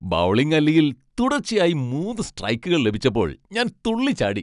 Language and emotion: Malayalam, happy